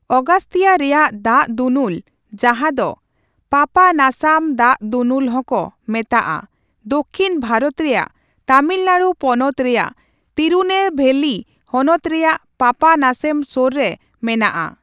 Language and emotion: Santali, neutral